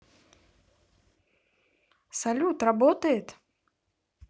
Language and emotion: Russian, positive